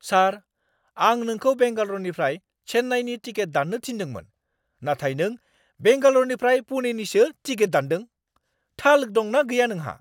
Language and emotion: Bodo, angry